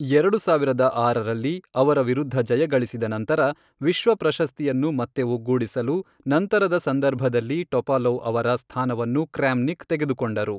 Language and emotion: Kannada, neutral